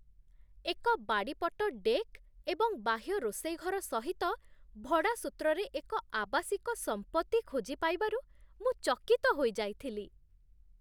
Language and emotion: Odia, surprised